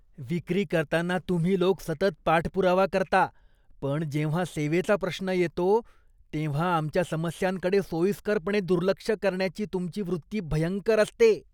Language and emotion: Marathi, disgusted